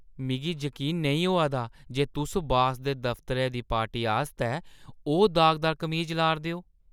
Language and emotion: Dogri, disgusted